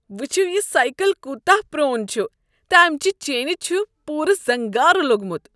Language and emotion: Kashmiri, disgusted